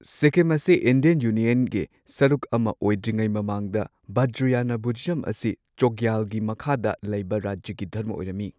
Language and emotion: Manipuri, neutral